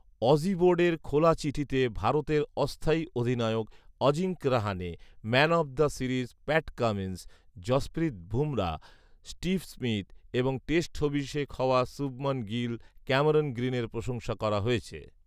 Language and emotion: Bengali, neutral